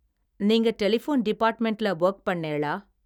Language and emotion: Tamil, neutral